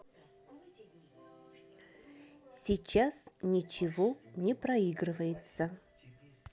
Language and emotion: Russian, neutral